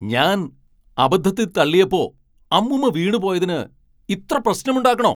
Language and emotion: Malayalam, angry